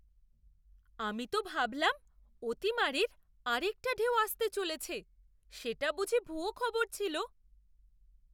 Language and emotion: Bengali, surprised